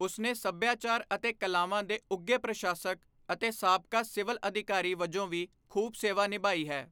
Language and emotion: Punjabi, neutral